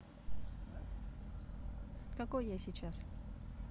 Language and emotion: Russian, neutral